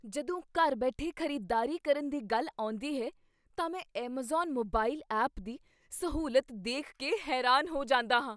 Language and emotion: Punjabi, surprised